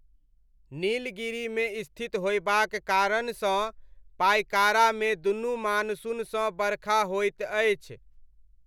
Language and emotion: Maithili, neutral